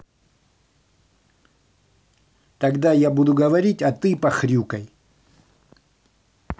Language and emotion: Russian, angry